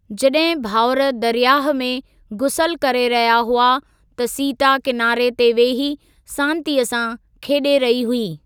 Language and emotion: Sindhi, neutral